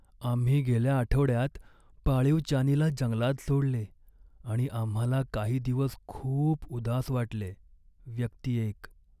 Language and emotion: Marathi, sad